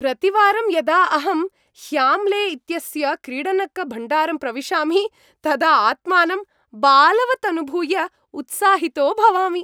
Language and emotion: Sanskrit, happy